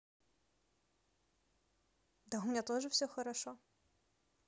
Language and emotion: Russian, neutral